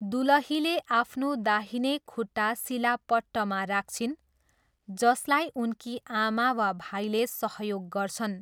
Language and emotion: Nepali, neutral